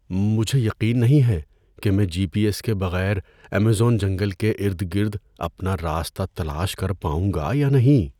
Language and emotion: Urdu, fearful